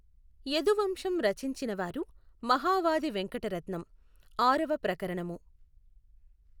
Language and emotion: Telugu, neutral